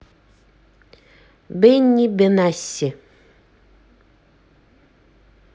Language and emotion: Russian, neutral